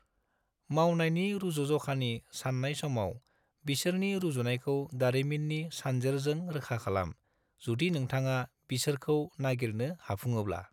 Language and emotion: Bodo, neutral